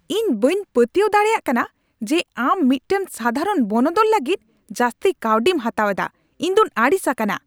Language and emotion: Santali, angry